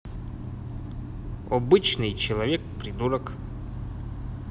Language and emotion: Russian, neutral